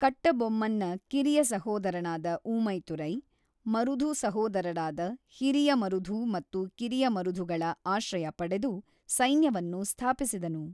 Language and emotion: Kannada, neutral